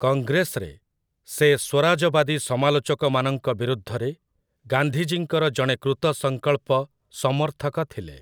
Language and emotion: Odia, neutral